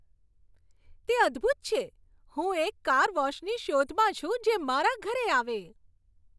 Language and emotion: Gujarati, happy